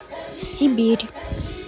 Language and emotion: Russian, neutral